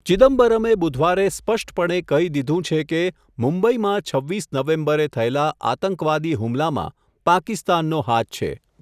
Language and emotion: Gujarati, neutral